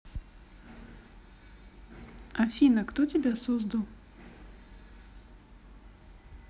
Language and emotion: Russian, neutral